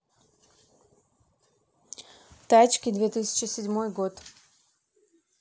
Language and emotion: Russian, neutral